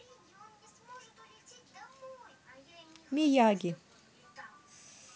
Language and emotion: Russian, neutral